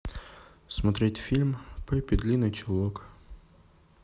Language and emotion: Russian, neutral